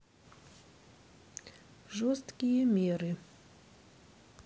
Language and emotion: Russian, neutral